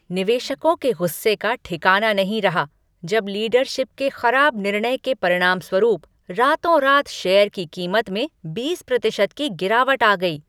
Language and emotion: Hindi, angry